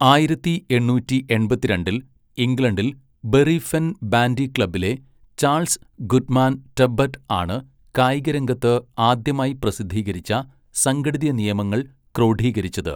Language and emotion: Malayalam, neutral